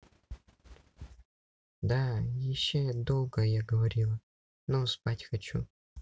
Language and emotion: Russian, neutral